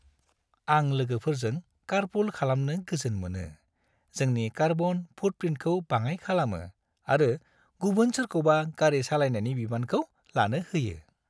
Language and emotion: Bodo, happy